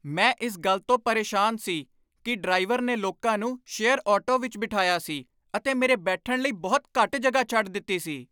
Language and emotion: Punjabi, angry